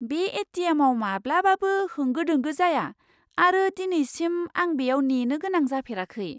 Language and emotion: Bodo, surprised